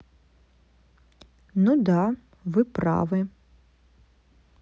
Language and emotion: Russian, neutral